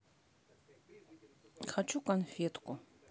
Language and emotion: Russian, neutral